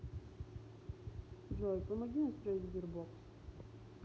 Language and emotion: Russian, neutral